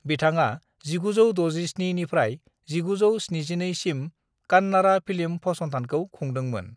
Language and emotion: Bodo, neutral